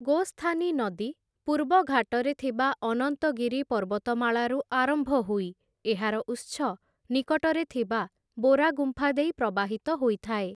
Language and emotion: Odia, neutral